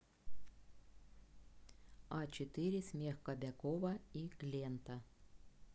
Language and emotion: Russian, neutral